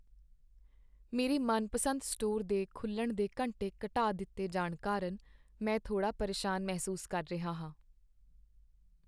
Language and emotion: Punjabi, sad